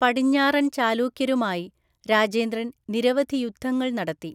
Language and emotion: Malayalam, neutral